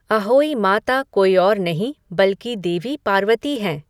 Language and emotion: Hindi, neutral